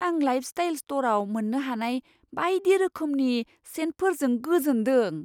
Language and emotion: Bodo, surprised